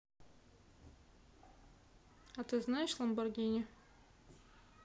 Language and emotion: Russian, neutral